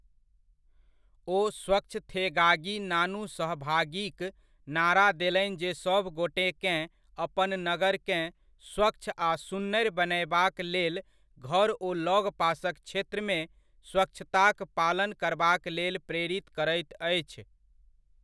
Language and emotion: Maithili, neutral